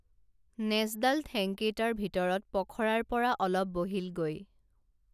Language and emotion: Assamese, neutral